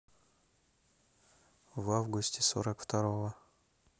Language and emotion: Russian, neutral